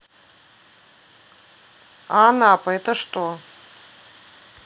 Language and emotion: Russian, neutral